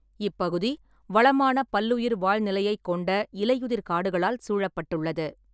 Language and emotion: Tamil, neutral